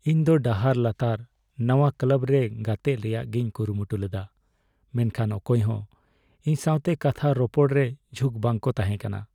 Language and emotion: Santali, sad